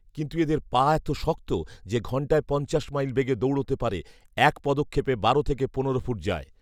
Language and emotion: Bengali, neutral